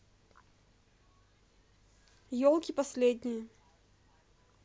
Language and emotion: Russian, neutral